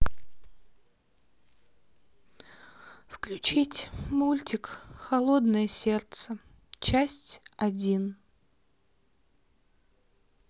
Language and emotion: Russian, sad